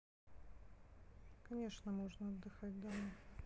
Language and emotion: Russian, neutral